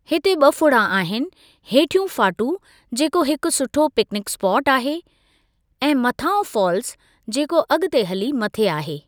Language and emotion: Sindhi, neutral